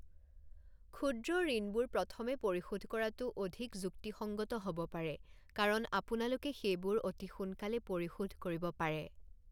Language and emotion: Assamese, neutral